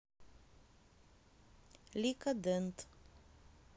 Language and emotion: Russian, neutral